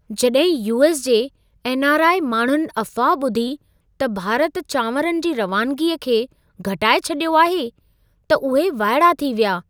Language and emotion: Sindhi, surprised